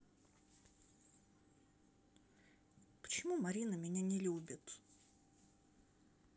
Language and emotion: Russian, sad